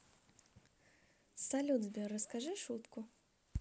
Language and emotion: Russian, positive